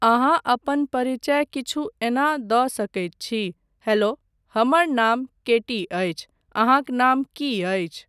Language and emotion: Maithili, neutral